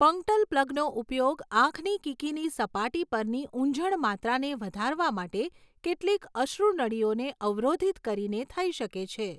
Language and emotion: Gujarati, neutral